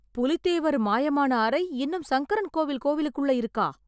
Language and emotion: Tamil, surprised